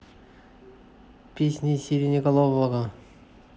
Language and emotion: Russian, neutral